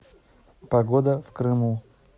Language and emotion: Russian, neutral